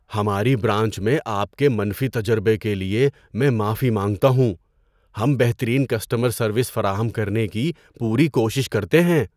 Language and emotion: Urdu, surprised